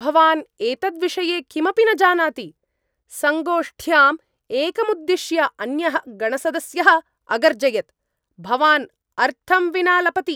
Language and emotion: Sanskrit, angry